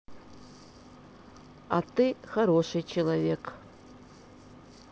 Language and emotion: Russian, neutral